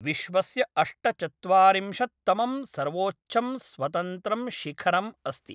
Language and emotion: Sanskrit, neutral